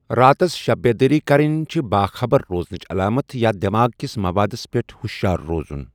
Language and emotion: Kashmiri, neutral